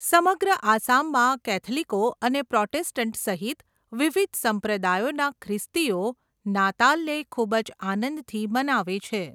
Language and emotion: Gujarati, neutral